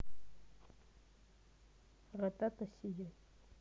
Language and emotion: Russian, neutral